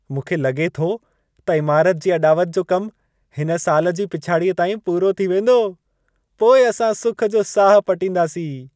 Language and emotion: Sindhi, happy